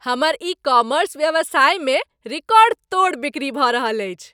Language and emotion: Maithili, happy